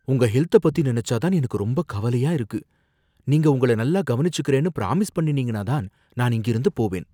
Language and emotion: Tamil, fearful